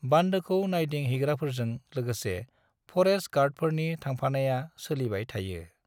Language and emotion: Bodo, neutral